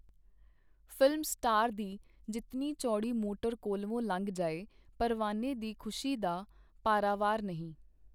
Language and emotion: Punjabi, neutral